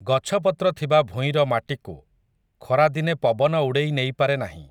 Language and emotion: Odia, neutral